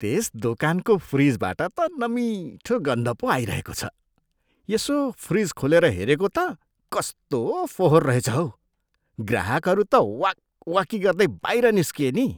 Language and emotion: Nepali, disgusted